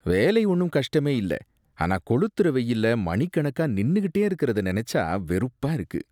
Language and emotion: Tamil, disgusted